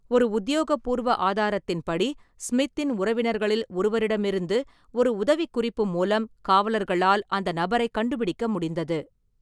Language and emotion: Tamil, neutral